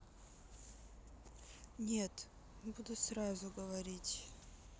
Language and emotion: Russian, sad